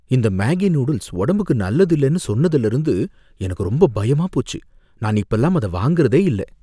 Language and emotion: Tamil, fearful